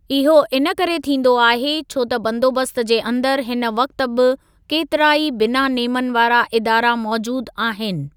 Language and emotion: Sindhi, neutral